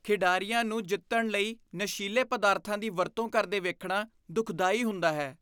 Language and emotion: Punjabi, disgusted